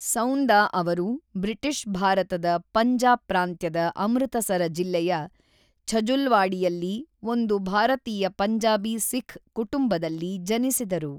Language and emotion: Kannada, neutral